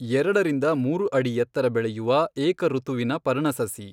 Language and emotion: Kannada, neutral